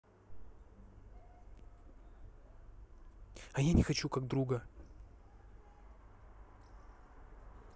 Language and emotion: Russian, angry